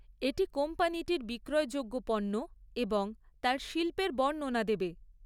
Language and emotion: Bengali, neutral